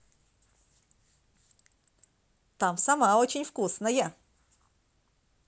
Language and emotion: Russian, positive